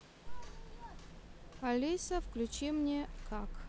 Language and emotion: Russian, neutral